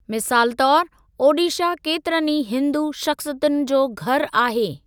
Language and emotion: Sindhi, neutral